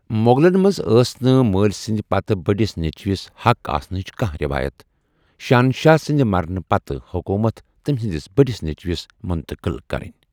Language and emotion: Kashmiri, neutral